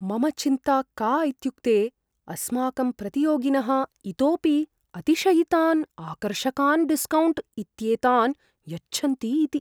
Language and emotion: Sanskrit, fearful